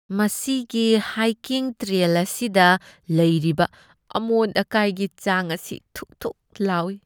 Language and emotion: Manipuri, disgusted